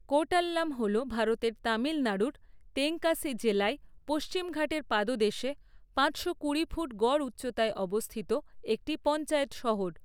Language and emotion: Bengali, neutral